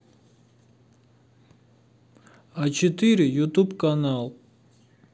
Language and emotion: Russian, neutral